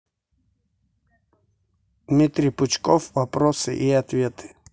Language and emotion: Russian, neutral